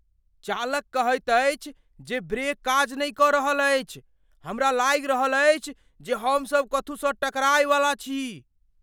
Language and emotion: Maithili, fearful